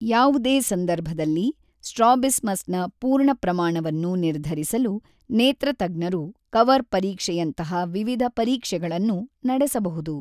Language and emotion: Kannada, neutral